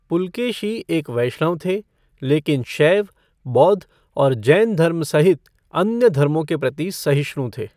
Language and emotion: Hindi, neutral